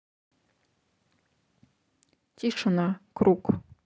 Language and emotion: Russian, neutral